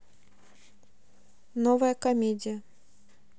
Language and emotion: Russian, neutral